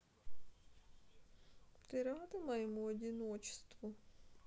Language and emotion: Russian, neutral